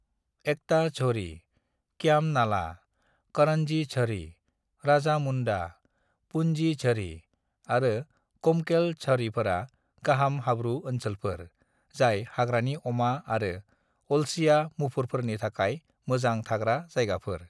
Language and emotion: Bodo, neutral